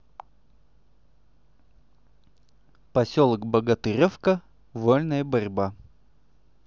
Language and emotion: Russian, neutral